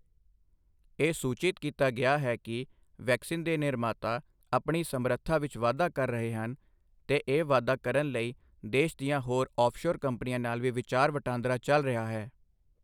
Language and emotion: Punjabi, neutral